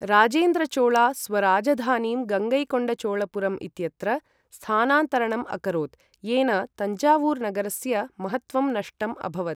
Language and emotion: Sanskrit, neutral